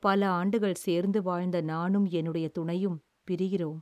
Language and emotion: Tamil, sad